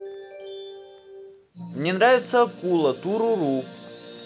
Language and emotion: Russian, positive